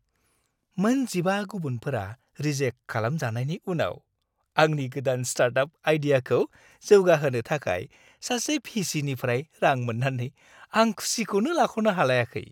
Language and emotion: Bodo, happy